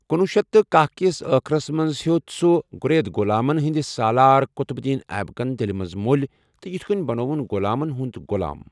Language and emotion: Kashmiri, neutral